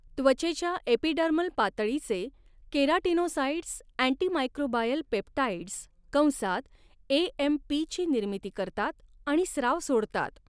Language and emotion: Marathi, neutral